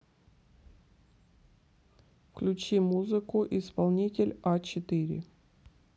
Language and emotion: Russian, neutral